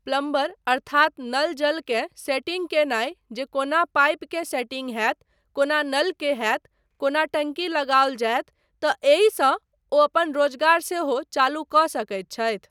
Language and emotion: Maithili, neutral